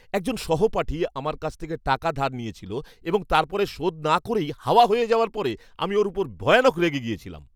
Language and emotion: Bengali, angry